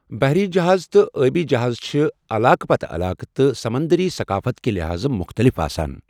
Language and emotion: Kashmiri, neutral